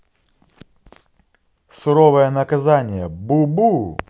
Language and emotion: Russian, positive